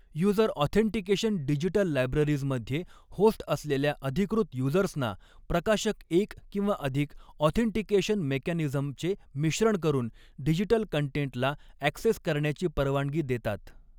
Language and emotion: Marathi, neutral